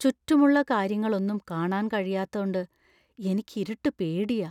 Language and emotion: Malayalam, fearful